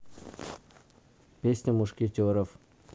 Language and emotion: Russian, neutral